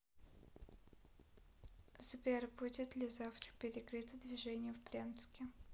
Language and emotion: Russian, neutral